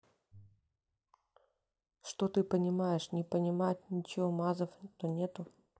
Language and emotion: Russian, neutral